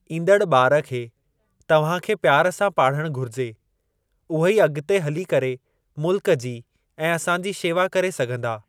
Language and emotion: Sindhi, neutral